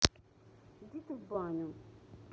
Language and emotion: Russian, neutral